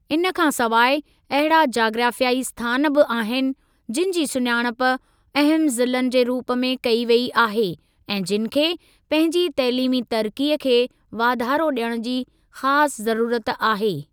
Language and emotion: Sindhi, neutral